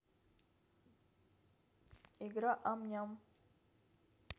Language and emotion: Russian, neutral